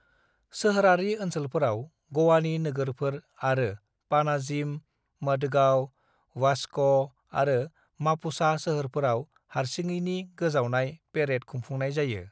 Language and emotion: Bodo, neutral